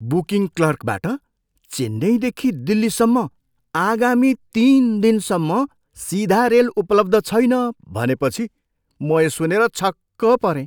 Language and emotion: Nepali, surprised